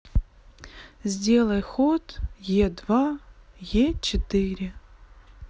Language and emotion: Russian, sad